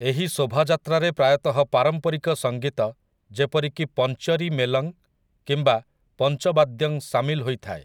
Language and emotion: Odia, neutral